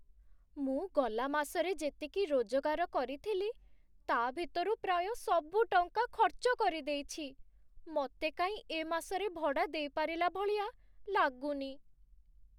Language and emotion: Odia, sad